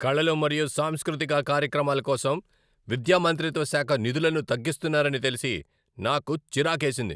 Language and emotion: Telugu, angry